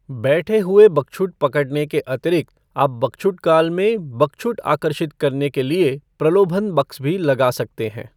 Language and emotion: Hindi, neutral